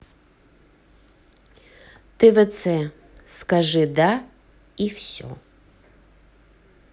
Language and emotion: Russian, neutral